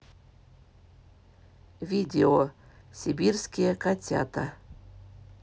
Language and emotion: Russian, neutral